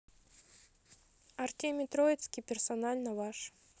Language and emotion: Russian, neutral